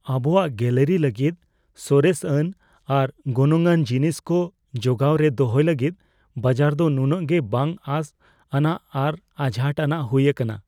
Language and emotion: Santali, fearful